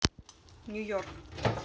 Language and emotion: Russian, neutral